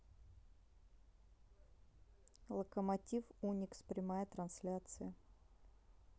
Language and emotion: Russian, neutral